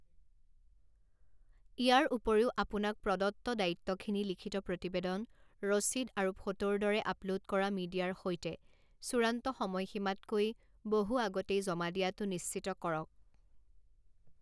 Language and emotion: Assamese, neutral